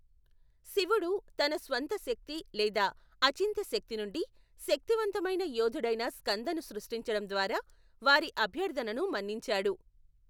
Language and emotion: Telugu, neutral